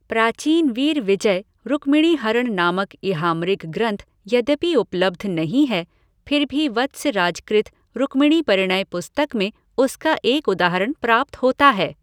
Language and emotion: Hindi, neutral